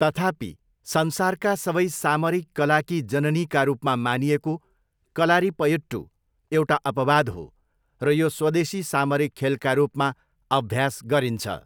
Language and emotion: Nepali, neutral